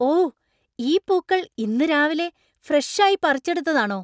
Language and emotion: Malayalam, surprised